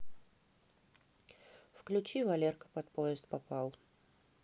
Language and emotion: Russian, neutral